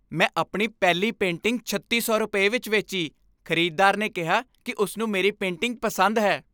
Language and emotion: Punjabi, happy